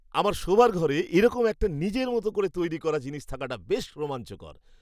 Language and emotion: Bengali, happy